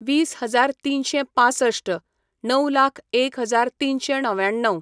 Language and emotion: Goan Konkani, neutral